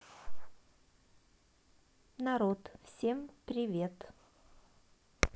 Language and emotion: Russian, neutral